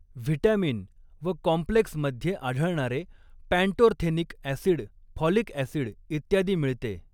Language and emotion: Marathi, neutral